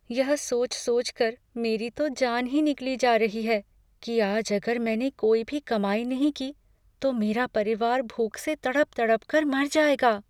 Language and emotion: Hindi, fearful